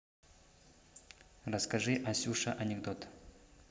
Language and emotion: Russian, neutral